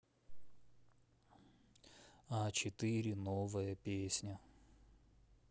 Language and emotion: Russian, neutral